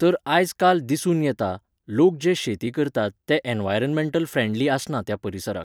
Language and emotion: Goan Konkani, neutral